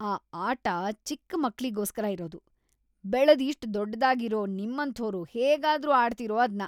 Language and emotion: Kannada, disgusted